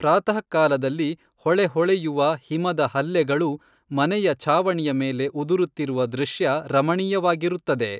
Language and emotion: Kannada, neutral